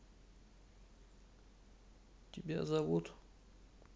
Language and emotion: Russian, sad